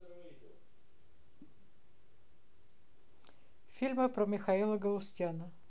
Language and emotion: Russian, neutral